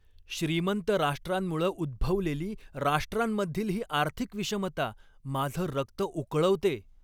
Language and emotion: Marathi, angry